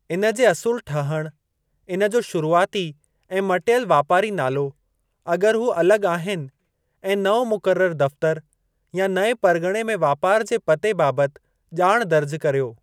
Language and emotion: Sindhi, neutral